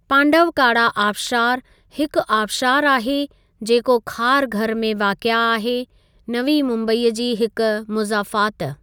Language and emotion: Sindhi, neutral